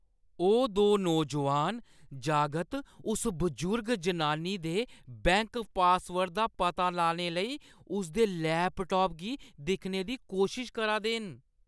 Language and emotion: Dogri, disgusted